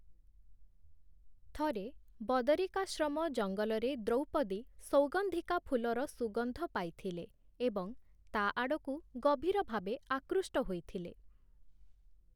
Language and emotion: Odia, neutral